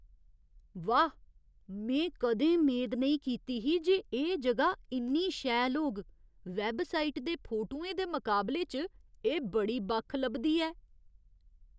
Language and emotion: Dogri, surprised